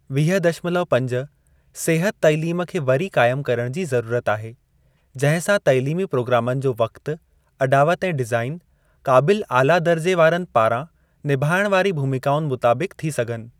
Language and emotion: Sindhi, neutral